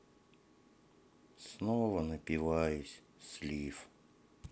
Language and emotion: Russian, sad